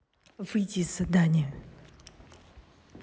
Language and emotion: Russian, angry